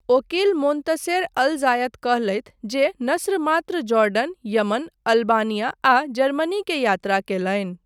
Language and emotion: Maithili, neutral